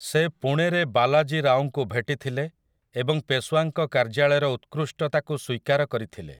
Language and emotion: Odia, neutral